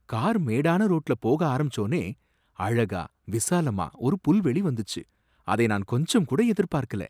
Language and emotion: Tamil, surprised